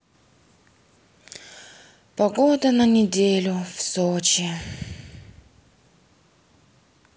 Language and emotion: Russian, sad